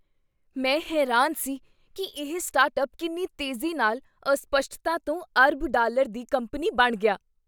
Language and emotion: Punjabi, surprised